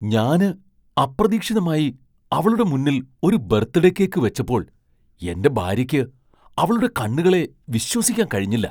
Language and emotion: Malayalam, surprised